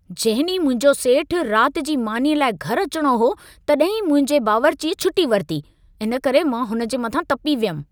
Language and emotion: Sindhi, angry